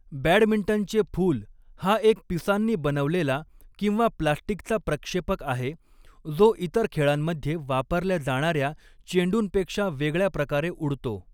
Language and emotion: Marathi, neutral